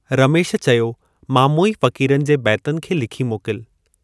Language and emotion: Sindhi, neutral